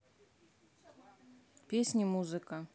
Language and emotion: Russian, neutral